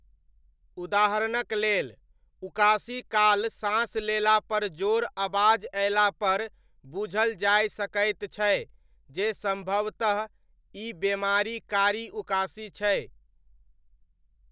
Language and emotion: Maithili, neutral